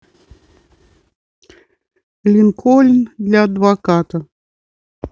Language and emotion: Russian, neutral